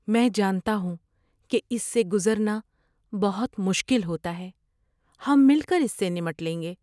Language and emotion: Urdu, sad